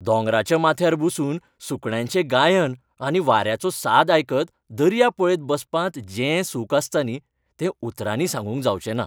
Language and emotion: Goan Konkani, happy